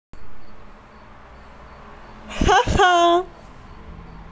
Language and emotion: Russian, positive